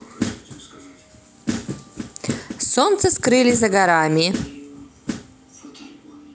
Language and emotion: Russian, positive